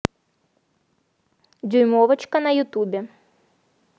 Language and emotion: Russian, neutral